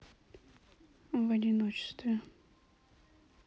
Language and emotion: Russian, neutral